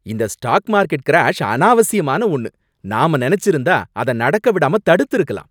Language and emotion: Tamil, angry